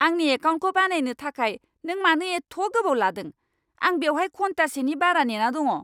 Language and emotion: Bodo, angry